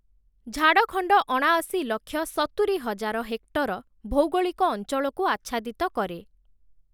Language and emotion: Odia, neutral